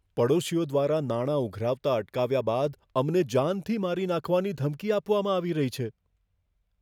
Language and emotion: Gujarati, fearful